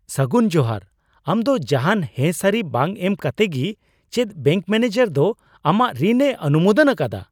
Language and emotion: Santali, surprised